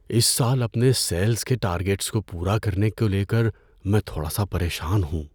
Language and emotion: Urdu, fearful